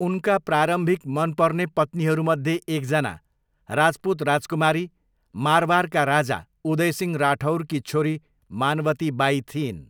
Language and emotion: Nepali, neutral